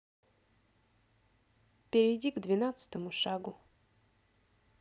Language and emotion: Russian, neutral